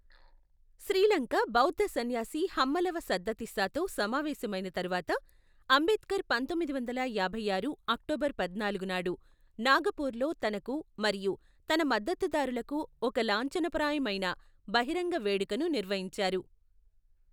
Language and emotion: Telugu, neutral